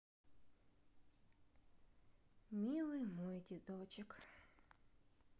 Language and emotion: Russian, sad